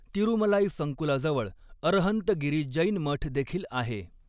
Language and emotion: Marathi, neutral